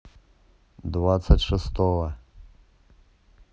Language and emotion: Russian, neutral